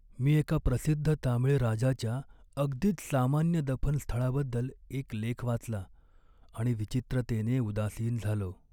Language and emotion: Marathi, sad